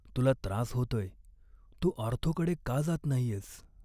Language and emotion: Marathi, sad